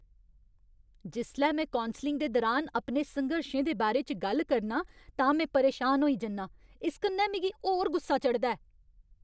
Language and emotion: Dogri, angry